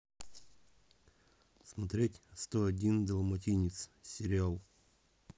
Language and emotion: Russian, neutral